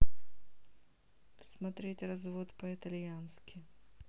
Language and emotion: Russian, neutral